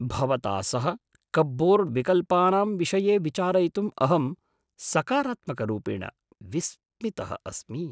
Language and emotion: Sanskrit, surprised